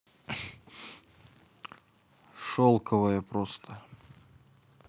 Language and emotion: Russian, neutral